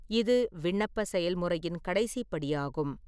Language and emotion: Tamil, neutral